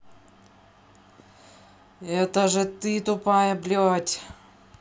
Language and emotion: Russian, angry